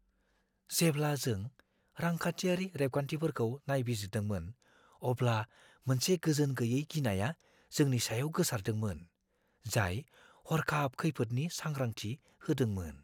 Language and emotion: Bodo, fearful